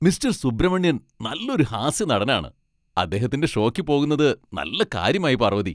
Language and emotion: Malayalam, happy